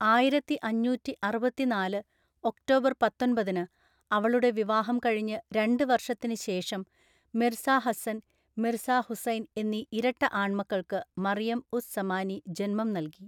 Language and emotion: Malayalam, neutral